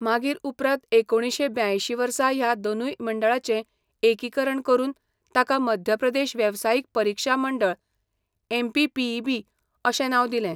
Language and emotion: Goan Konkani, neutral